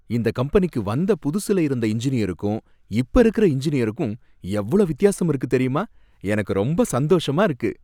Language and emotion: Tamil, happy